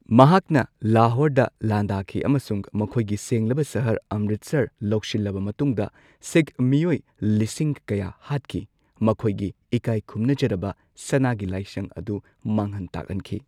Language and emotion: Manipuri, neutral